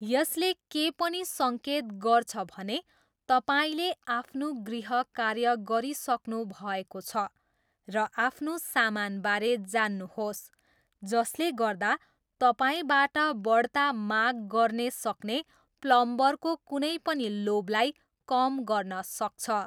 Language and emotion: Nepali, neutral